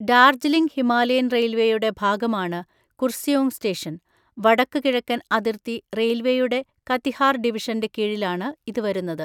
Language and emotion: Malayalam, neutral